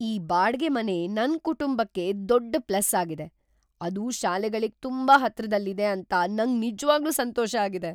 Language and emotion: Kannada, surprised